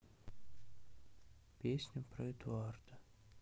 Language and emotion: Russian, sad